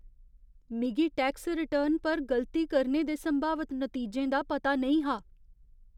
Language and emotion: Dogri, fearful